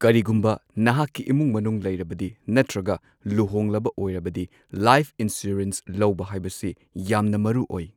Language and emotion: Manipuri, neutral